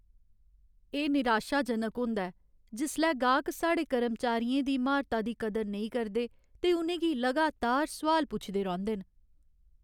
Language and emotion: Dogri, sad